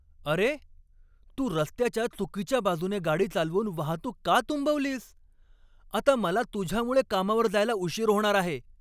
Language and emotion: Marathi, angry